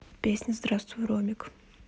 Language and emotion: Russian, neutral